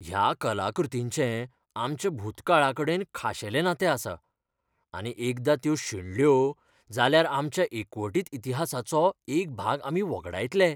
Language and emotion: Goan Konkani, fearful